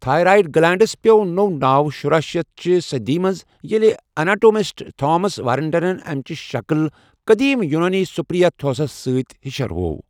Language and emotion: Kashmiri, neutral